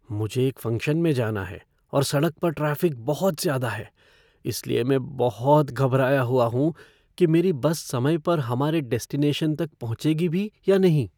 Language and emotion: Hindi, fearful